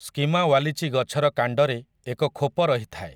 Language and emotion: Odia, neutral